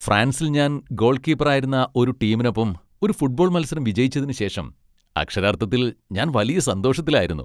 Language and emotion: Malayalam, happy